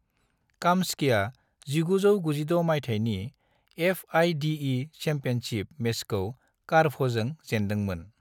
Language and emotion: Bodo, neutral